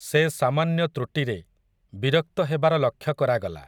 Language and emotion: Odia, neutral